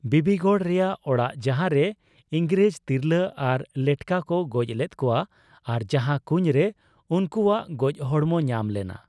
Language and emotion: Santali, neutral